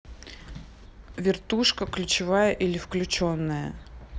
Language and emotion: Russian, neutral